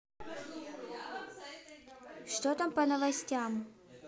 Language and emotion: Russian, neutral